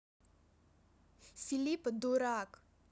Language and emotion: Russian, neutral